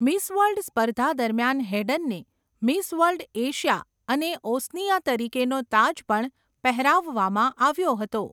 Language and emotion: Gujarati, neutral